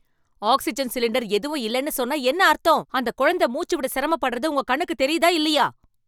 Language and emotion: Tamil, angry